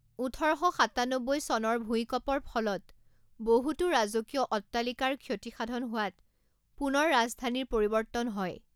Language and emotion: Assamese, neutral